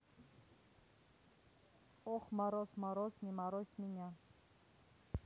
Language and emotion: Russian, neutral